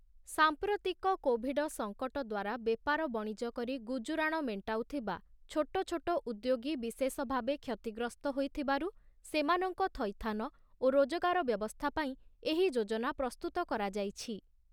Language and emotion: Odia, neutral